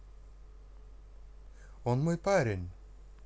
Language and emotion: Russian, positive